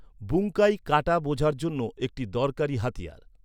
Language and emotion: Bengali, neutral